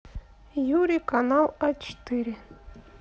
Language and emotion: Russian, neutral